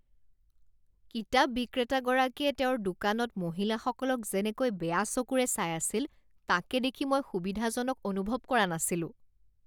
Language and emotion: Assamese, disgusted